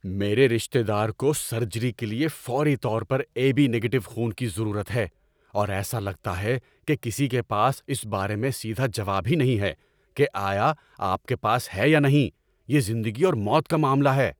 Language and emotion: Urdu, angry